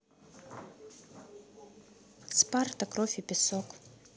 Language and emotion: Russian, neutral